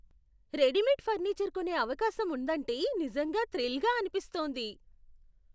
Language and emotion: Telugu, surprised